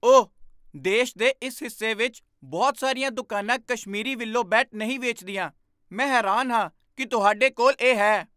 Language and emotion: Punjabi, surprised